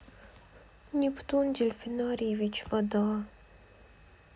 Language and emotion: Russian, sad